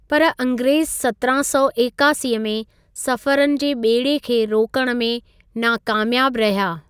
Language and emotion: Sindhi, neutral